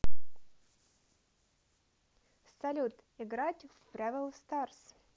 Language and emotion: Russian, positive